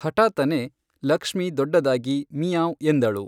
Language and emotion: Kannada, neutral